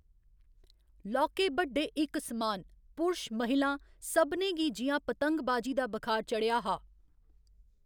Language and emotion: Dogri, neutral